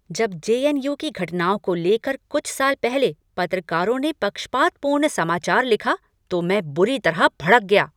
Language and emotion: Hindi, angry